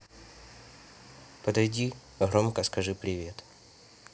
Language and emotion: Russian, neutral